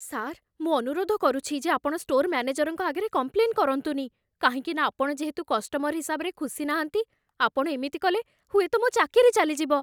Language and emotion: Odia, fearful